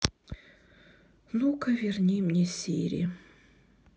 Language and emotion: Russian, sad